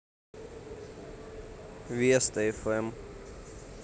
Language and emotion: Russian, neutral